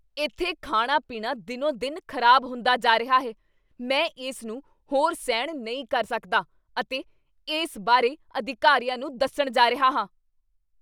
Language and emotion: Punjabi, angry